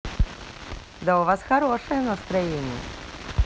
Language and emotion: Russian, positive